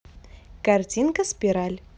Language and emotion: Russian, positive